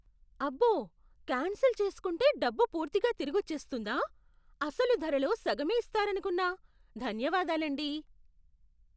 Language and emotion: Telugu, surprised